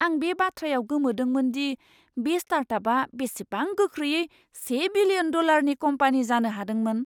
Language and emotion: Bodo, surprised